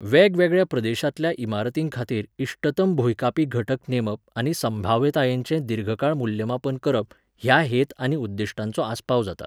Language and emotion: Goan Konkani, neutral